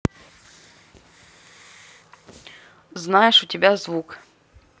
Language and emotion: Russian, neutral